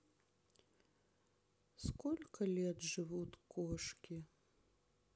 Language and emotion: Russian, sad